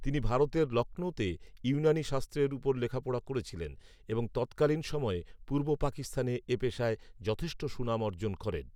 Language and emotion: Bengali, neutral